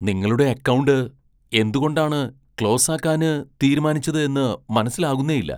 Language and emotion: Malayalam, surprised